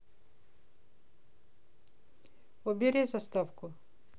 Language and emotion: Russian, neutral